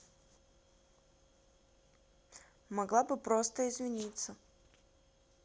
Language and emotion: Russian, neutral